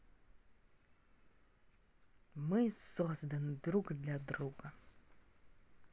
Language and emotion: Russian, positive